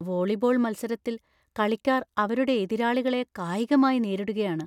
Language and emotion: Malayalam, fearful